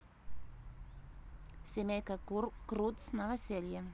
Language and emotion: Russian, neutral